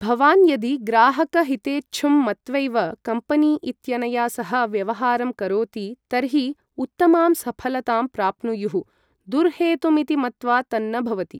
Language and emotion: Sanskrit, neutral